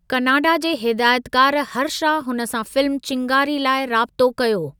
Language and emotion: Sindhi, neutral